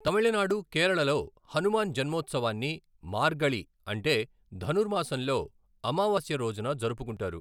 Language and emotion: Telugu, neutral